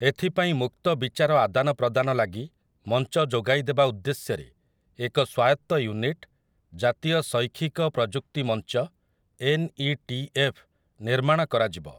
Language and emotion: Odia, neutral